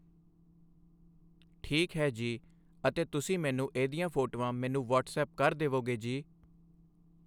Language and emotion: Punjabi, neutral